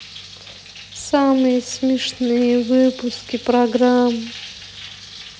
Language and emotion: Russian, sad